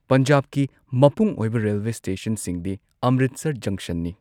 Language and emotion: Manipuri, neutral